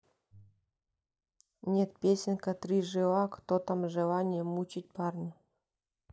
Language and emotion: Russian, neutral